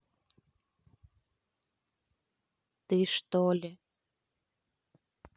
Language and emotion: Russian, neutral